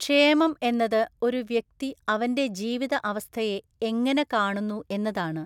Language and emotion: Malayalam, neutral